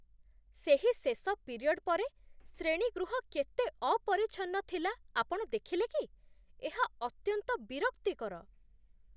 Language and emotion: Odia, disgusted